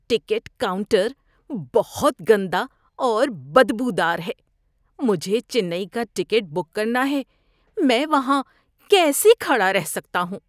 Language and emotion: Urdu, disgusted